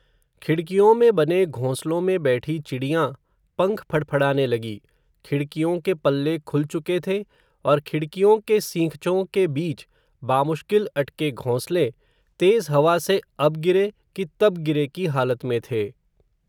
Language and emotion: Hindi, neutral